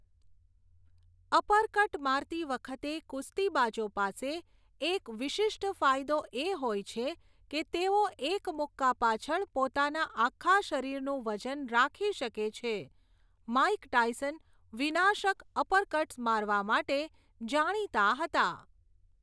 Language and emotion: Gujarati, neutral